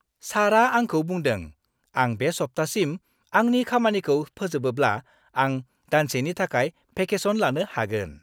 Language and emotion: Bodo, happy